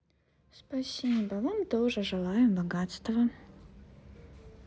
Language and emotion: Russian, neutral